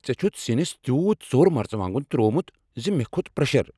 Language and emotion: Kashmiri, angry